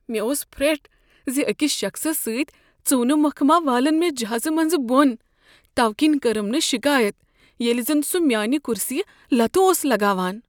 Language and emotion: Kashmiri, fearful